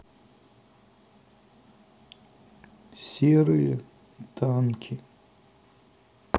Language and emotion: Russian, sad